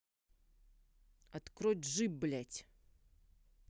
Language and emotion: Russian, angry